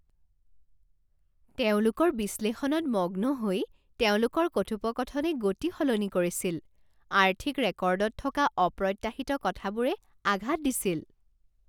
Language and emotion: Assamese, surprised